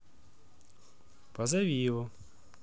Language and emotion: Russian, neutral